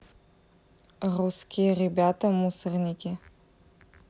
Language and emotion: Russian, neutral